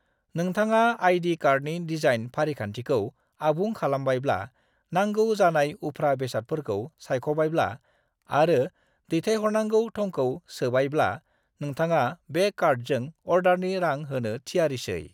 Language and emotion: Bodo, neutral